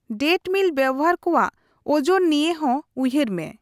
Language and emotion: Santali, neutral